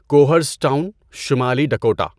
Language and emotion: Urdu, neutral